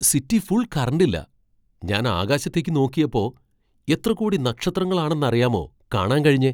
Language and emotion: Malayalam, surprised